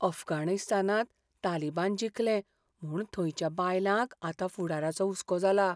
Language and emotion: Goan Konkani, fearful